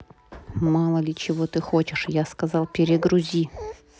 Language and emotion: Russian, angry